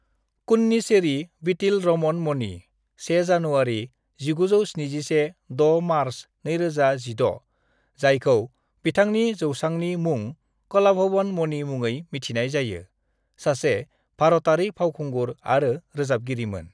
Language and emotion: Bodo, neutral